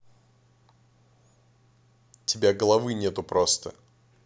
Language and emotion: Russian, neutral